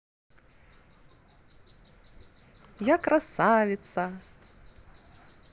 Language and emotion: Russian, positive